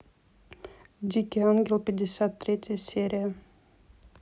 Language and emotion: Russian, neutral